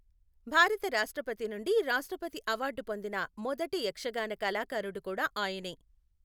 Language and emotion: Telugu, neutral